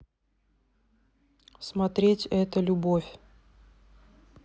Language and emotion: Russian, neutral